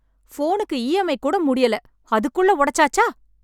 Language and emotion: Tamil, angry